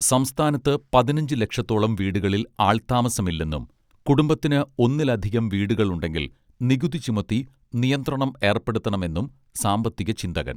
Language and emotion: Malayalam, neutral